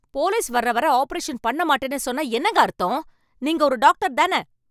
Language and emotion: Tamil, angry